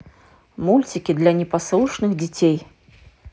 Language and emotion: Russian, neutral